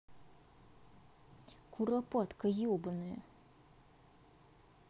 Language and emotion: Russian, angry